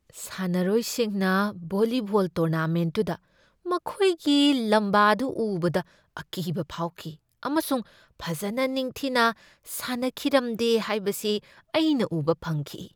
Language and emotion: Manipuri, fearful